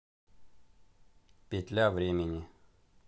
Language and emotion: Russian, neutral